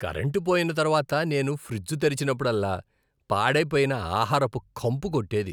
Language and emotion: Telugu, disgusted